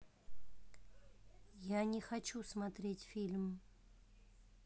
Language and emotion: Russian, neutral